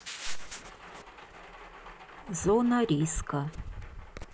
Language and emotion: Russian, neutral